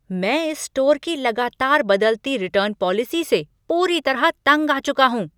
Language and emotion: Hindi, angry